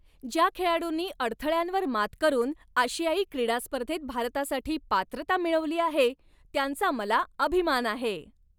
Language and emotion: Marathi, happy